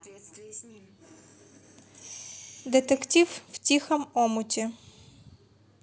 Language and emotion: Russian, neutral